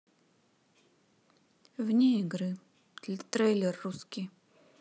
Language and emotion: Russian, neutral